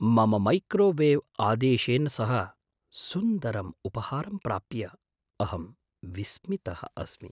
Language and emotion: Sanskrit, surprised